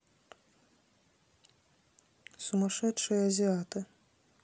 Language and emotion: Russian, neutral